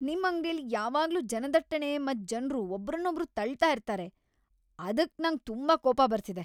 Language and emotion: Kannada, angry